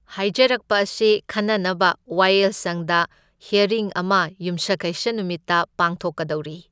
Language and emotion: Manipuri, neutral